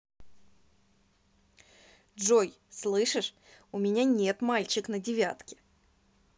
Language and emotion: Russian, neutral